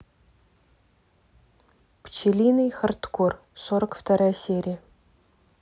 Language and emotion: Russian, neutral